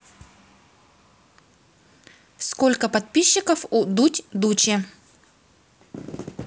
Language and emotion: Russian, neutral